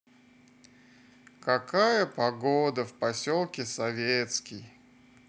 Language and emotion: Russian, sad